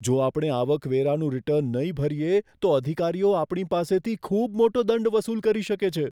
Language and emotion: Gujarati, fearful